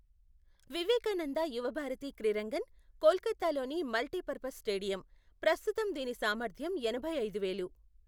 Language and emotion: Telugu, neutral